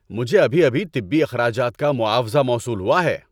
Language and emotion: Urdu, happy